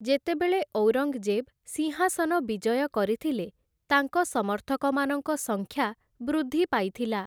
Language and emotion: Odia, neutral